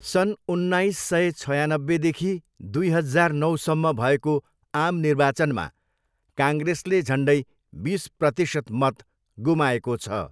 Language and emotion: Nepali, neutral